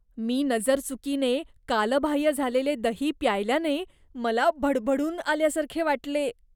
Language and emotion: Marathi, disgusted